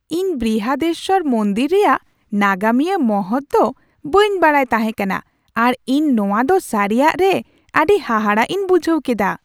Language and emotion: Santali, surprised